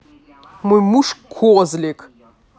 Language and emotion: Russian, angry